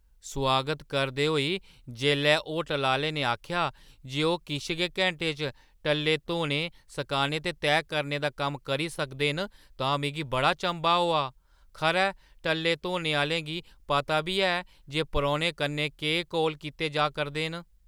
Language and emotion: Dogri, surprised